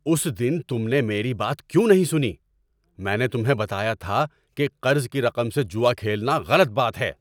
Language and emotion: Urdu, angry